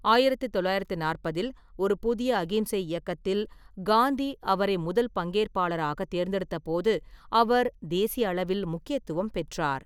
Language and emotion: Tamil, neutral